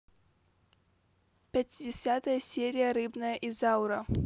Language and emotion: Russian, neutral